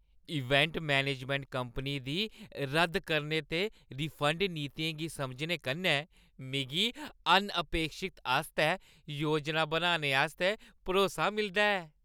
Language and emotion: Dogri, happy